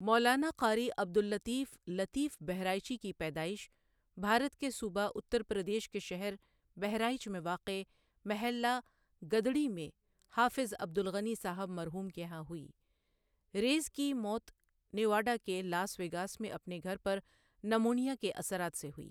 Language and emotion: Urdu, neutral